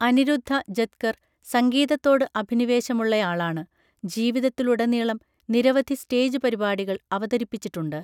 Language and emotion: Malayalam, neutral